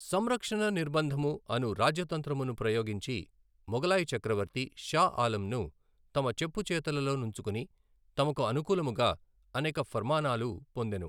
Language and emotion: Telugu, neutral